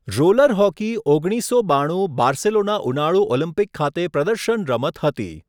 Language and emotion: Gujarati, neutral